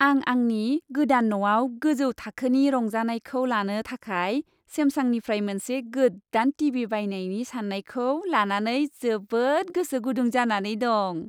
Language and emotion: Bodo, happy